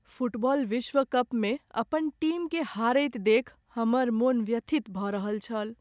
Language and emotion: Maithili, sad